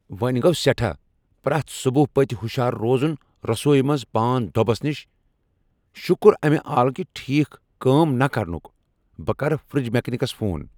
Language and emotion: Kashmiri, angry